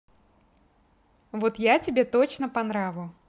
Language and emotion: Russian, positive